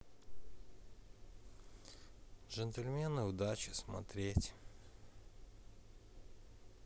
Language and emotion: Russian, sad